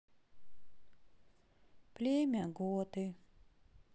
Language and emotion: Russian, sad